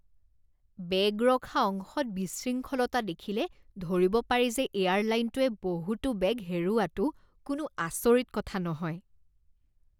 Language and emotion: Assamese, disgusted